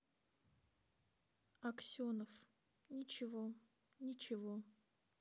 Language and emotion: Russian, sad